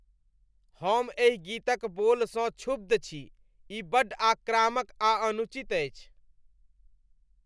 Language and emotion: Maithili, disgusted